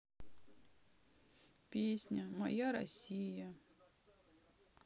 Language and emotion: Russian, sad